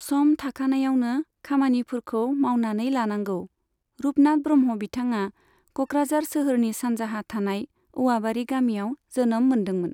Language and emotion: Bodo, neutral